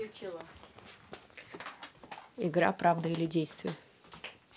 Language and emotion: Russian, neutral